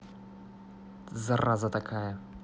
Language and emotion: Russian, angry